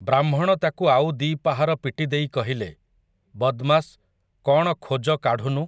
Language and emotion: Odia, neutral